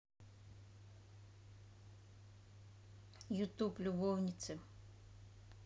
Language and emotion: Russian, neutral